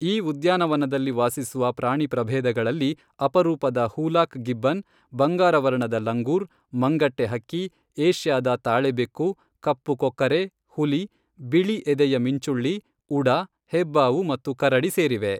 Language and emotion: Kannada, neutral